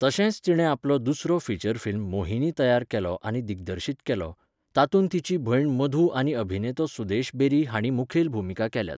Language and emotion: Goan Konkani, neutral